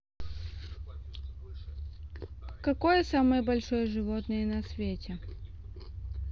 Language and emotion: Russian, neutral